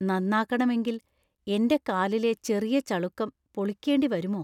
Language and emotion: Malayalam, fearful